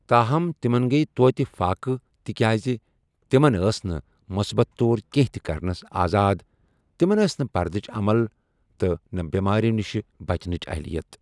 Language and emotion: Kashmiri, neutral